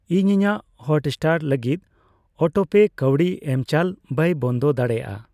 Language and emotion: Santali, neutral